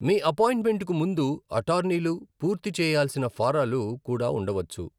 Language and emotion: Telugu, neutral